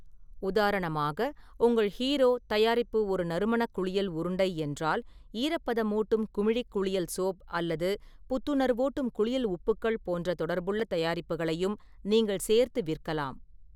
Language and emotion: Tamil, neutral